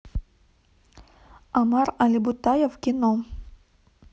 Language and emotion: Russian, neutral